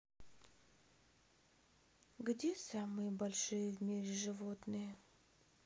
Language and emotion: Russian, sad